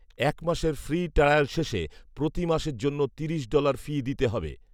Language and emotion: Bengali, neutral